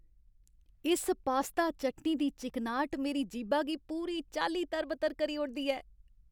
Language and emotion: Dogri, happy